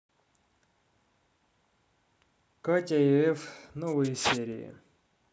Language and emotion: Russian, neutral